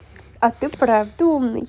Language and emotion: Russian, positive